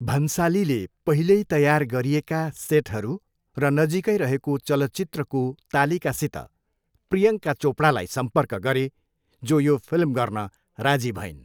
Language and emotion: Nepali, neutral